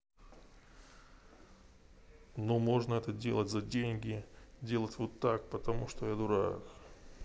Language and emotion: Russian, neutral